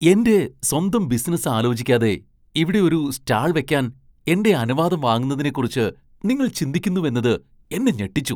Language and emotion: Malayalam, surprised